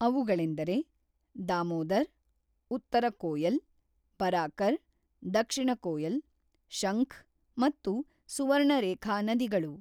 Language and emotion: Kannada, neutral